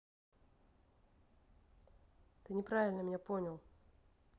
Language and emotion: Russian, neutral